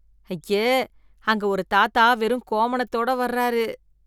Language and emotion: Tamil, disgusted